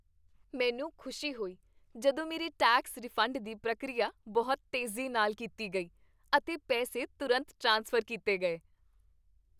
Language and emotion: Punjabi, happy